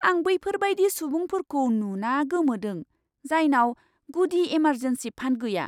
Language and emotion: Bodo, surprised